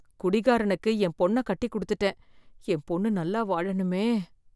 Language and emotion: Tamil, fearful